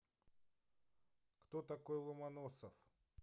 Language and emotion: Russian, neutral